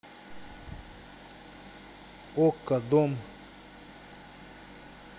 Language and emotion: Russian, neutral